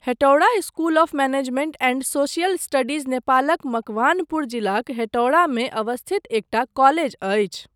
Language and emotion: Maithili, neutral